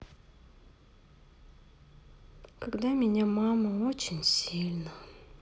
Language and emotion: Russian, sad